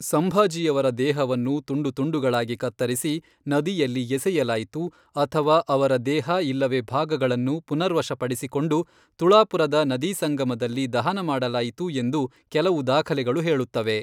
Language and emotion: Kannada, neutral